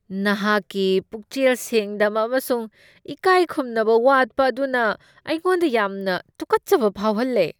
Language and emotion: Manipuri, disgusted